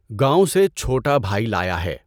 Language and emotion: Urdu, neutral